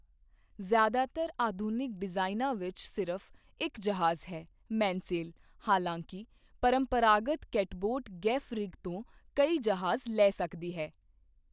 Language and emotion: Punjabi, neutral